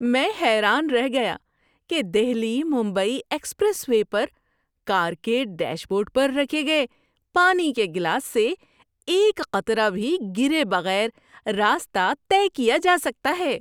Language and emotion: Urdu, surprised